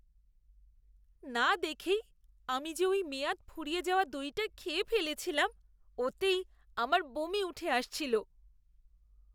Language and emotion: Bengali, disgusted